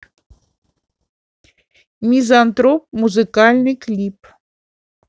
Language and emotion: Russian, neutral